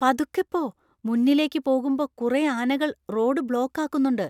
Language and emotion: Malayalam, fearful